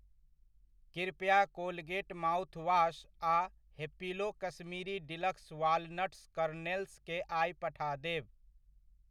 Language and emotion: Maithili, neutral